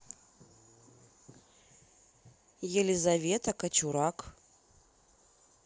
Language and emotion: Russian, neutral